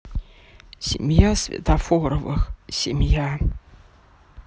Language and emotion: Russian, sad